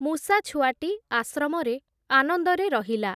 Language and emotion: Odia, neutral